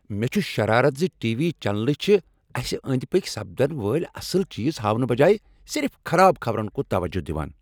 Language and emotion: Kashmiri, angry